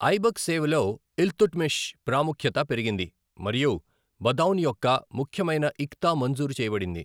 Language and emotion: Telugu, neutral